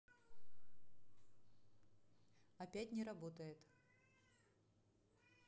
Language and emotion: Russian, neutral